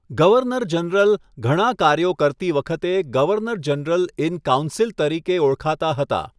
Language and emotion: Gujarati, neutral